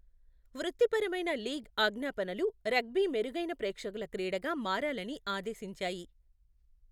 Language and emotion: Telugu, neutral